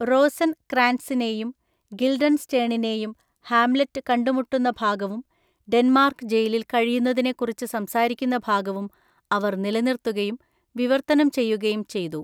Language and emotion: Malayalam, neutral